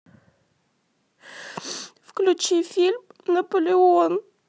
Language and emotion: Russian, sad